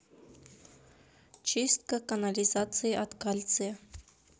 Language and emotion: Russian, neutral